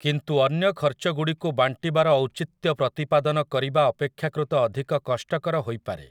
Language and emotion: Odia, neutral